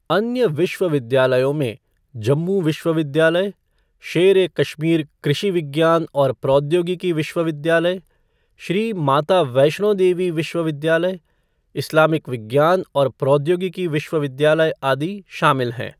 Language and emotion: Hindi, neutral